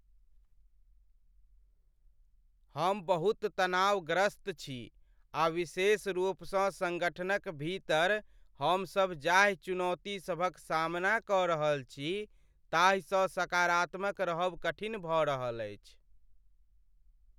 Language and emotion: Maithili, sad